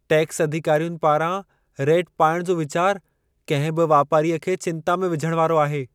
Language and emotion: Sindhi, fearful